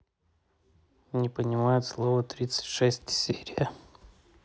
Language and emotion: Russian, neutral